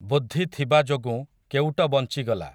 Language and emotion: Odia, neutral